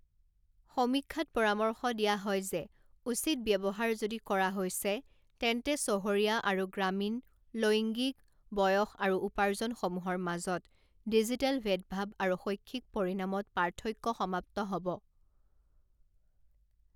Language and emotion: Assamese, neutral